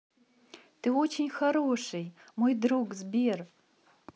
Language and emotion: Russian, positive